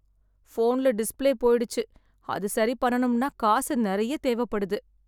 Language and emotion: Tamil, sad